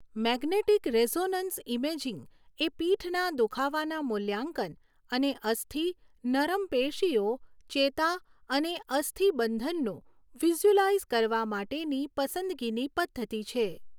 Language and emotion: Gujarati, neutral